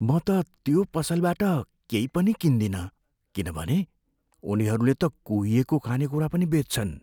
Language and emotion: Nepali, fearful